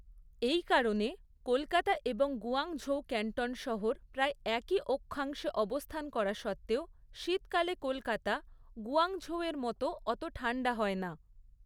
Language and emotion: Bengali, neutral